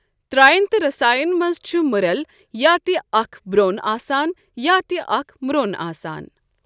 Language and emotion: Kashmiri, neutral